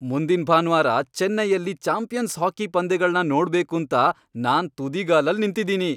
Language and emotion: Kannada, happy